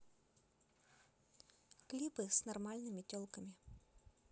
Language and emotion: Russian, neutral